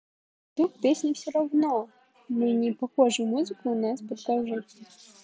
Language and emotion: Russian, neutral